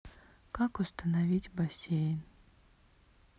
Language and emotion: Russian, sad